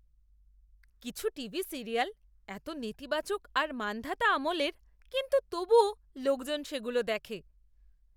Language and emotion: Bengali, disgusted